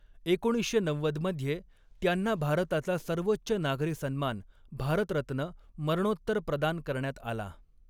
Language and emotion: Marathi, neutral